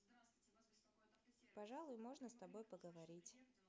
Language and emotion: Russian, neutral